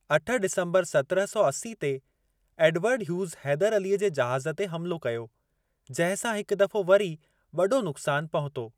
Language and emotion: Sindhi, neutral